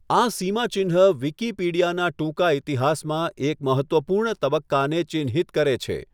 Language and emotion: Gujarati, neutral